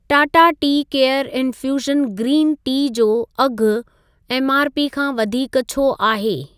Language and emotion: Sindhi, neutral